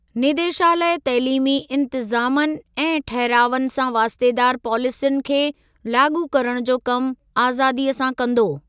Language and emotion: Sindhi, neutral